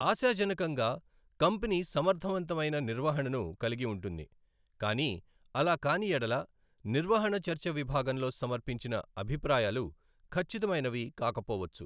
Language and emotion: Telugu, neutral